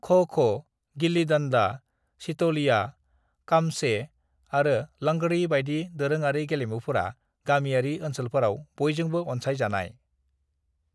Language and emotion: Bodo, neutral